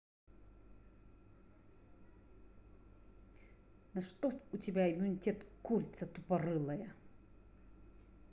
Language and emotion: Russian, angry